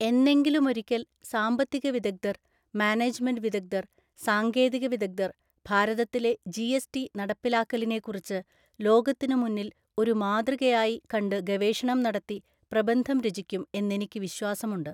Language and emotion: Malayalam, neutral